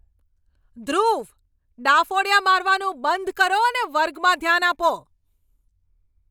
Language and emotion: Gujarati, angry